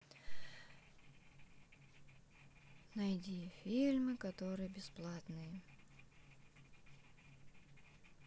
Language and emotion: Russian, sad